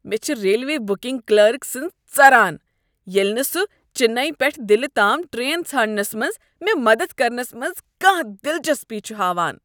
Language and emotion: Kashmiri, disgusted